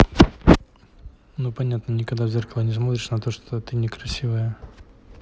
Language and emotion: Russian, neutral